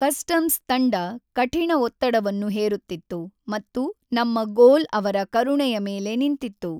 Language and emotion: Kannada, neutral